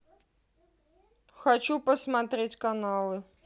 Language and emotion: Russian, neutral